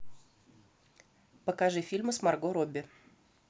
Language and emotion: Russian, neutral